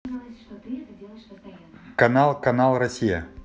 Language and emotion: Russian, neutral